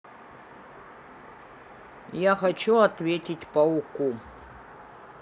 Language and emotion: Russian, neutral